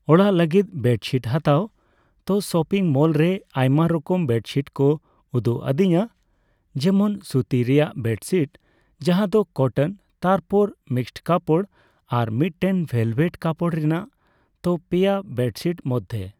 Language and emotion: Santali, neutral